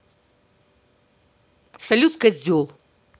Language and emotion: Russian, angry